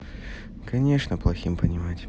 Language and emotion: Russian, neutral